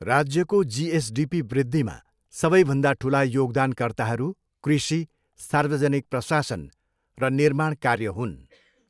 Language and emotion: Nepali, neutral